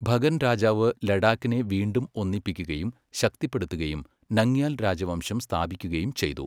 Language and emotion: Malayalam, neutral